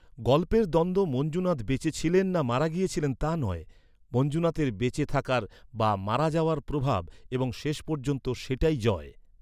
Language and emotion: Bengali, neutral